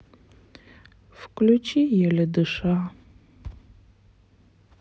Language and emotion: Russian, sad